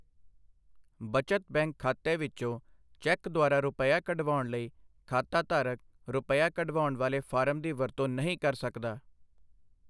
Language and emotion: Punjabi, neutral